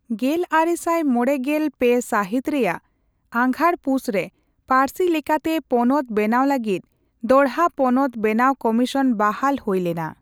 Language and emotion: Santali, neutral